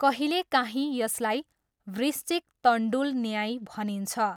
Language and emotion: Nepali, neutral